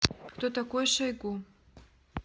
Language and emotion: Russian, neutral